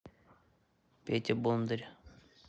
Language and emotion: Russian, neutral